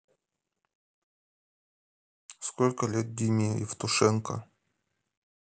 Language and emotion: Russian, neutral